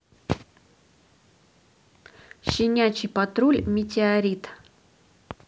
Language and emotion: Russian, neutral